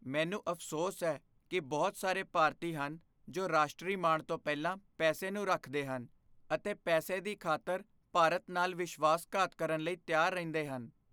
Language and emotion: Punjabi, fearful